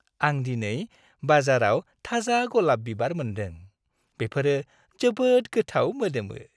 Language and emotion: Bodo, happy